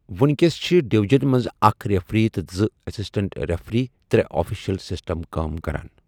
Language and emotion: Kashmiri, neutral